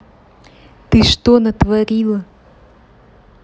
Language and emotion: Russian, neutral